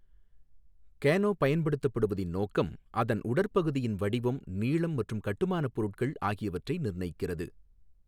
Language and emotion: Tamil, neutral